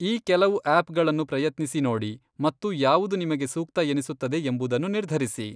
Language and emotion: Kannada, neutral